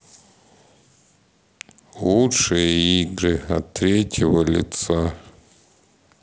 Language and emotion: Russian, sad